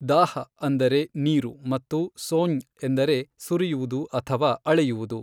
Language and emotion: Kannada, neutral